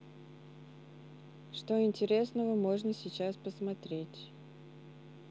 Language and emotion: Russian, neutral